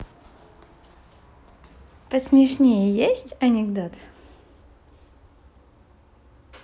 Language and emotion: Russian, positive